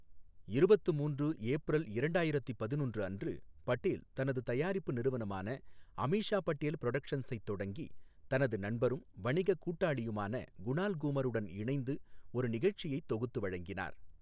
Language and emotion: Tamil, neutral